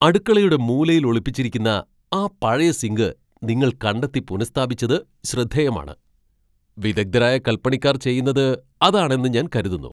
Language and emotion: Malayalam, surprised